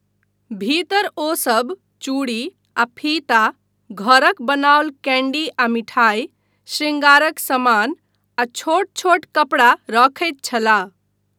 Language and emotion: Maithili, neutral